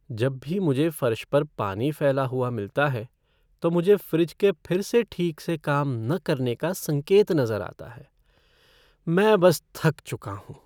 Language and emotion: Hindi, sad